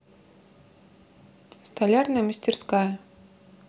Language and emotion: Russian, neutral